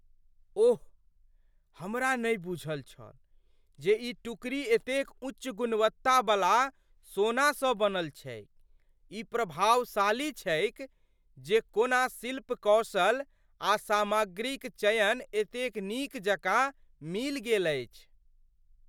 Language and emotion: Maithili, surprised